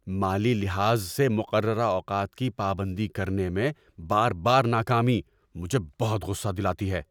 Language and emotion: Urdu, angry